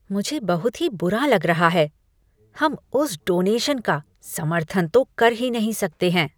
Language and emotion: Hindi, disgusted